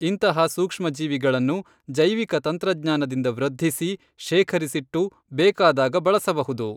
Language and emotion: Kannada, neutral